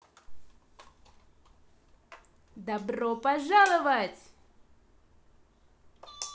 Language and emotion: Russian, positive